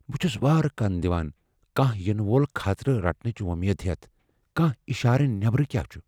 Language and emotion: Kashmiri, fearful